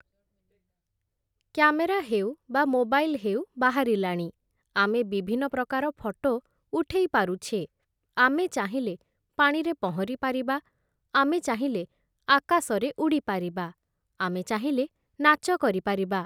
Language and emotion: Odia, neutral